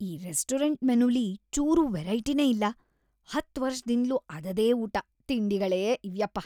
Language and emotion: Kannada, disgusted